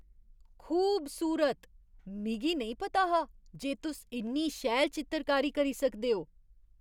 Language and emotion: Dogri, surprised